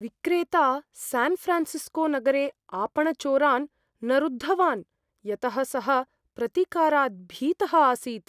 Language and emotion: Sanskrit, fearful